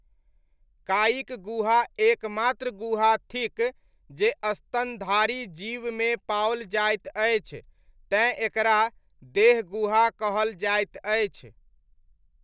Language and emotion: Maithili, neutral